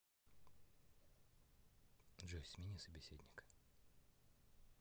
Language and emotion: Russian, neutral